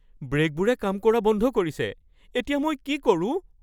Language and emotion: Assamese, fearful